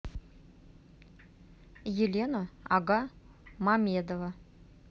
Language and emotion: Russian, neutral